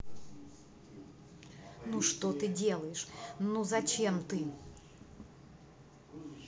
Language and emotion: Russian, angry